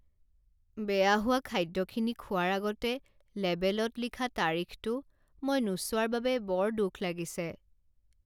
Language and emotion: Assamese, sad